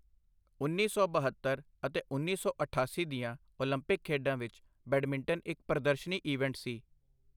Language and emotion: Punjabi, neutral